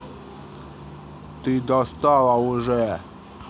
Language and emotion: Russian, angry